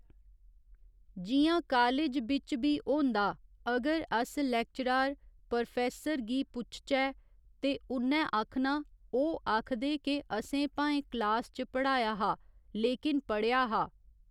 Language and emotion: Dogri, neutral